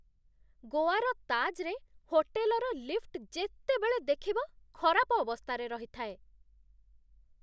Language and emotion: Odia, disgusted